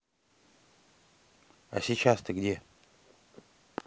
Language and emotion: Russian, neutral